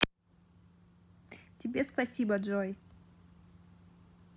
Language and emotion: Russian, positive